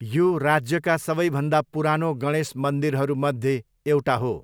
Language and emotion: Nepali, neutral